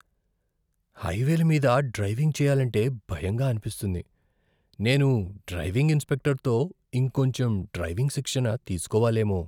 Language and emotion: Telugu, fearful